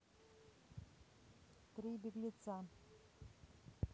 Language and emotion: Russian, neutral